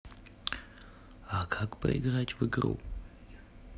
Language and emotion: Russian, neutral